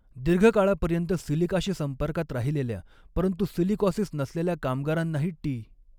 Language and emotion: Marathi, neutral